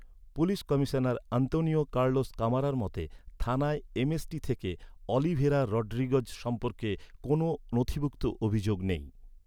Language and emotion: Bengali, neutral